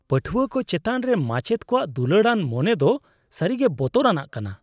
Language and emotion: Santali, disgusted